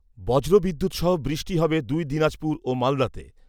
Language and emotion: Bengali, neutral